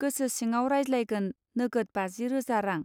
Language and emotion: Bodo, neutral